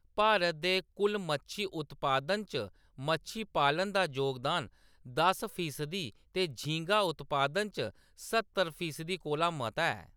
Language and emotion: Dogri, neutral